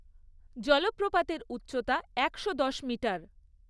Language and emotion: Bengali, neutral